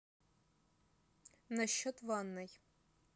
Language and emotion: Russian, neutral